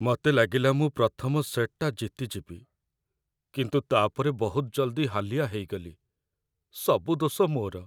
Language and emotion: Odia, sad